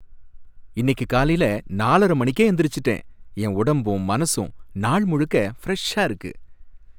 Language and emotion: Tamil, happy